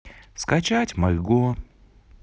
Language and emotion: Russian, neutral